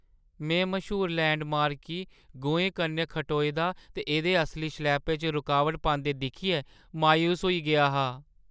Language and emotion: Dogri, sad